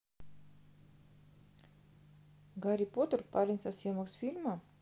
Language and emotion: Russian, neutral